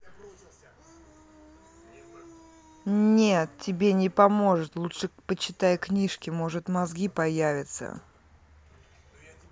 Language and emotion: Russian, angry